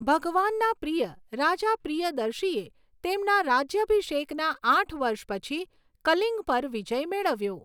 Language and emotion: Gujarati, neutral